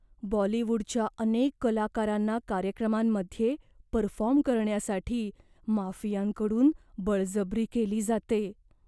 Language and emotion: Marathi, fearful